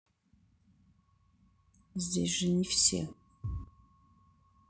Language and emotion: Russian, sad